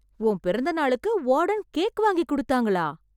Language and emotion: Tamil, surprised